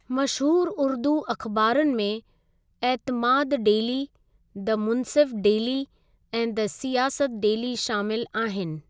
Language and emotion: Sindhi, neutral